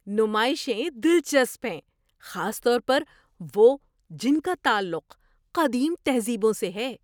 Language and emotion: Urdu, surprised